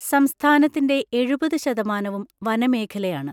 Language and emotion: Malayalam, neutral